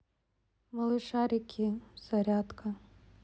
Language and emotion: Russian, neutral